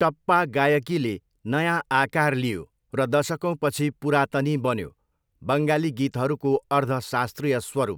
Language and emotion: Nepali, neutral